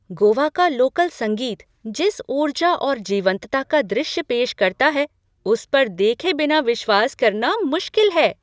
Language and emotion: Hindi, surprised